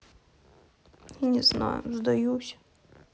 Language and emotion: Russian, sad